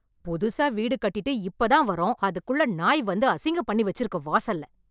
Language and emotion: Tamil, angry